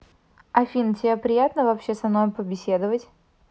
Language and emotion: Russian, neutral